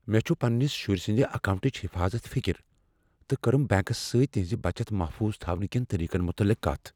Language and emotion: Kashmiri, fearful